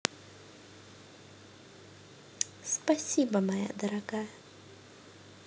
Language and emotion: Russian, neutral